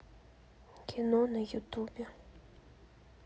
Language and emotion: Russian, sad